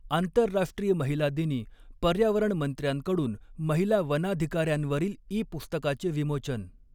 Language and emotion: Marathi, neutral